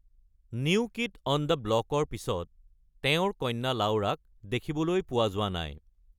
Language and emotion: Assamese, neutral